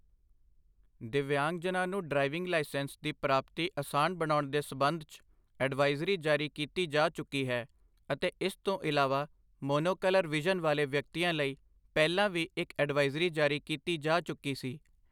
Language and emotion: Punjabi, neutral